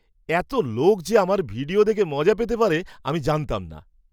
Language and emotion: Bengali, surprised